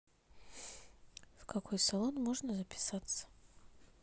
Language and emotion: Russian, neutral